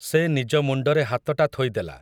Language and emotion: Odia, neutral